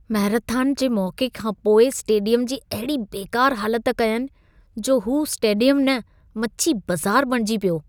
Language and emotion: Sindhi, disgusted